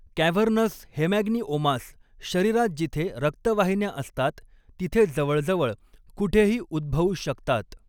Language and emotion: Marathi, neutral